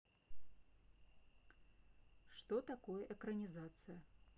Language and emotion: Russian, neutral